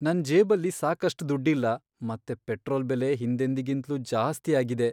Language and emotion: Kannada, sad